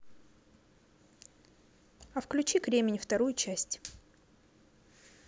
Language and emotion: Russian, neutral